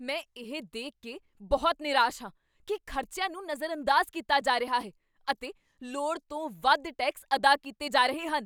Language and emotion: Punjabi, angry